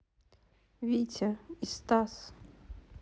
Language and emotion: Russian, neutral